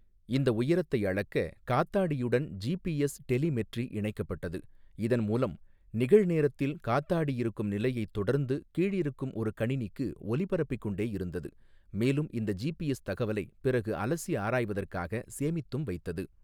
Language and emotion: Tamil, neutral